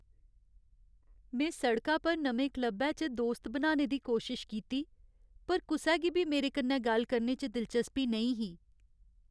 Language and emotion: Dogri, sad